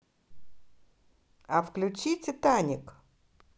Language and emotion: Russian, positive